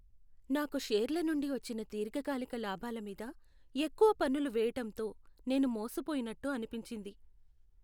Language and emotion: Telugu, sad